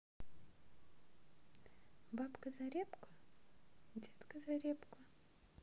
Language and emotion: Russian, neutral